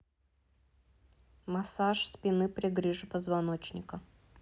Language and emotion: Russian, neutral